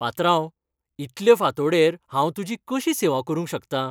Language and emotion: Goan Konkani, happy